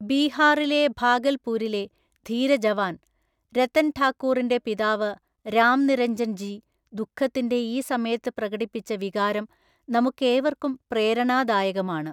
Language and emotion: Malayalam, neutral